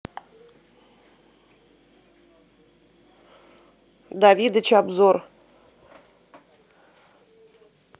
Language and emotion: Russian, neutral